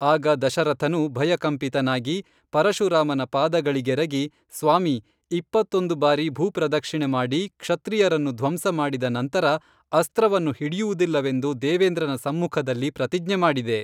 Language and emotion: Kannada, neutral